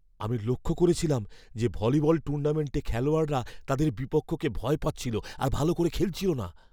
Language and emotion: Bengali, fearful